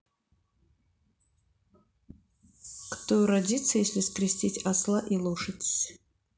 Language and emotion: Russian, neutral